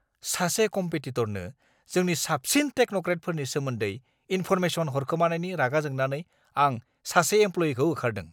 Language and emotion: Bodo, angry